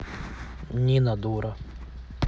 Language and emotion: Russian, neutral